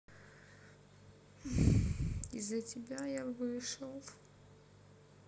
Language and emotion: Russian, sad